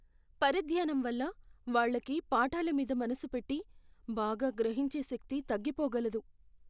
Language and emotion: Telugu, fearful